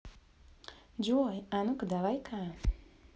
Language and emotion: Russian, positive